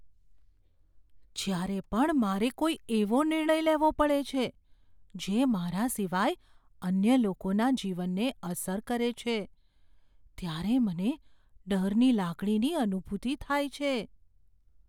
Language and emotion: Gujarati, fearful